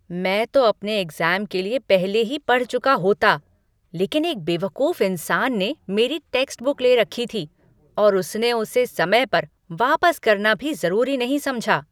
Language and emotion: Hindi, angry